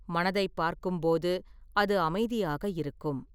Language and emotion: Tamil, neutral